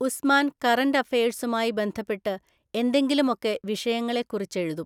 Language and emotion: Malayalam, neutral